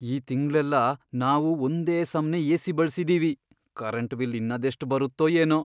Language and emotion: Kannada, fearful